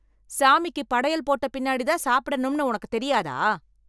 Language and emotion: Tamil, angry